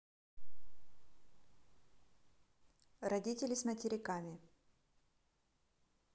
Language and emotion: Russian, neutral